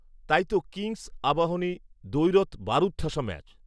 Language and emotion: Bengali, neutral